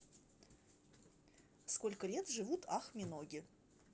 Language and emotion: Russian, neutral